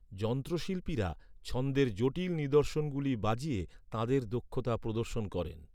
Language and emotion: Bengali, neutral